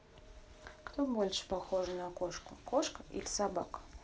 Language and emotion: Russian, neutral